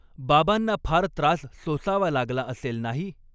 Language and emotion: Marathi, neutral